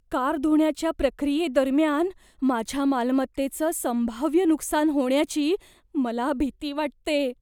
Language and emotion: Marathi, fearful